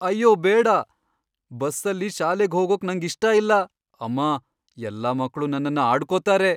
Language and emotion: Kannada, fearful